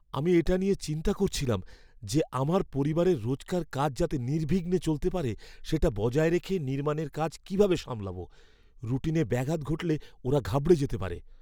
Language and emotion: Bengali, fearful